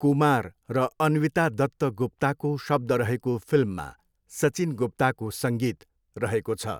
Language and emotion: Nepali, neutral